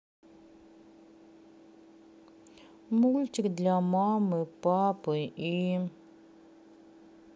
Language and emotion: Russian, sad